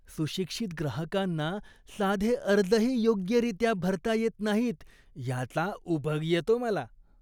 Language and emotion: Marathi, disgusted